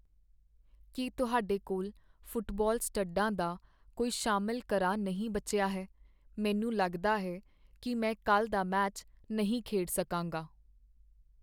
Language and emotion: Punjabi, sad